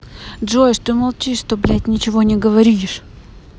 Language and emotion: Russian, angry